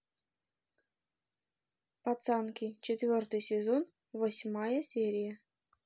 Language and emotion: Russian, neutral